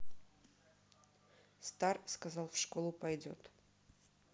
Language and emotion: Russian, neutral